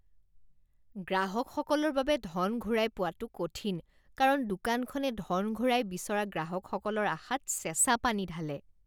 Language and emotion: Assamese, disgusted